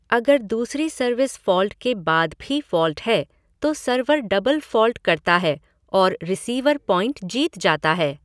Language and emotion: Hindi, neutral